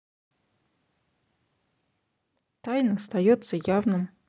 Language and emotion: Russian, neutral